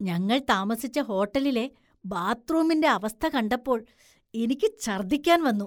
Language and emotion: Malayalam, disgusted